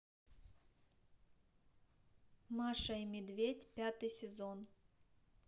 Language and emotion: Russian, neutral